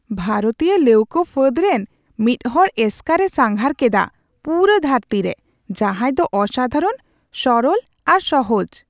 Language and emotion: Santali, surprised